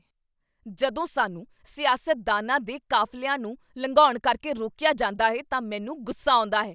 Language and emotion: Punjabi, angry